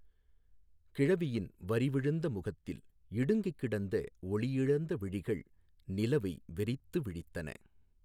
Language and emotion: Tamil, neutral